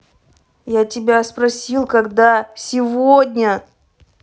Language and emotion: Russian, angry